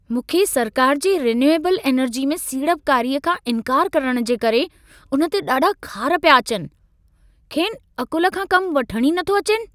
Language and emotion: Sindhi, angry